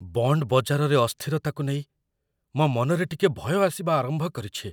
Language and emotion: Odia, fearful